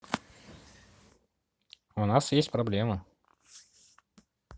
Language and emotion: Russian, neutral